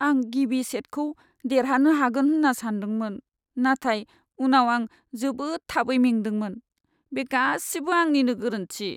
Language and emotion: Bodo, sad